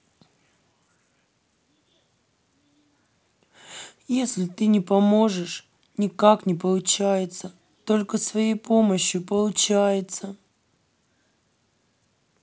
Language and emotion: Russian, sad